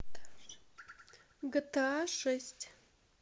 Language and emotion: Russian, neutral